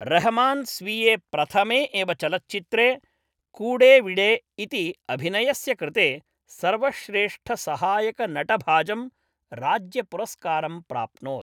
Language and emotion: Sanskrit, neutral